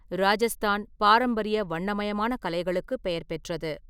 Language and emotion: Tamil, neutral